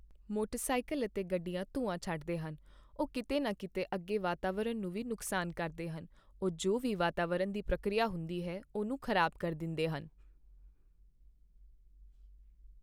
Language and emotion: Punjabi, neutral